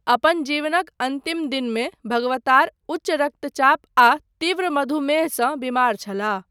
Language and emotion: Maithili, neutral